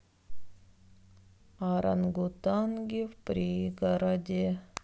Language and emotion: Russian, sad